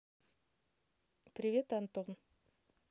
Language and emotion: Russian, neutral